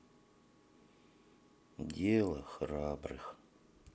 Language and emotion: Russian, sad